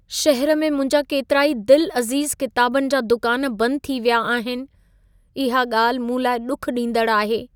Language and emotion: Sindhi, sad